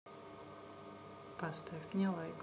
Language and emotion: Russian, neutral